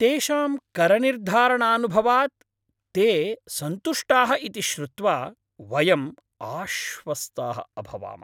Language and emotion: Sanskrit, happy